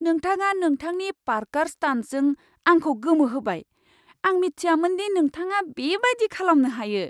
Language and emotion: Bodo, surprised